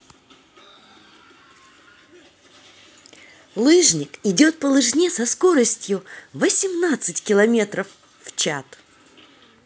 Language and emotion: Russian, positive